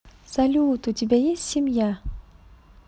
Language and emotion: Russian, positive